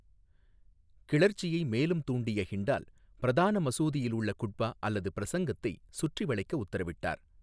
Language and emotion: Tamil, neutral